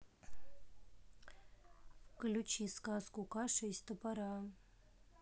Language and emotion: Russian, neutral